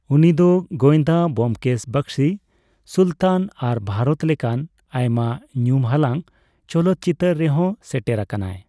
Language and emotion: Santali, neutral